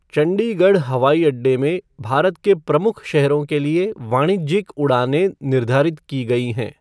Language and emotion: Hindi, neutral